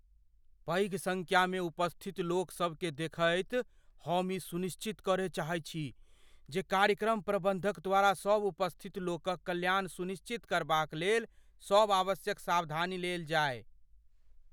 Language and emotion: Maithili, fearful